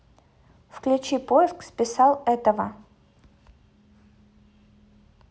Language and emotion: Russian, neutral